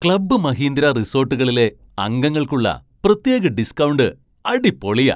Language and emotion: Malayalam, surprised